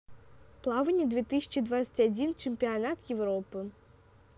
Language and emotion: Russian, neutral